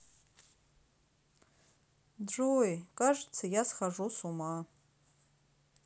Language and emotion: Russian, sad